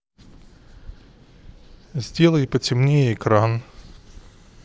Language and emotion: Russian, neutral